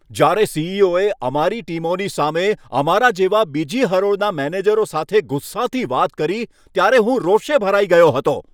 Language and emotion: Gujarati, angry